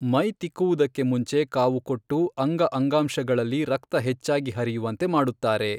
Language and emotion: Kannada, neutral